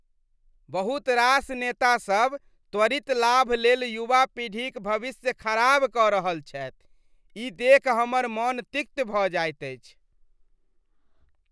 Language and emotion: Maithili, disgusted